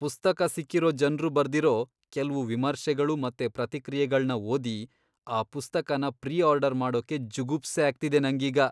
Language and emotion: Kannada, disgusted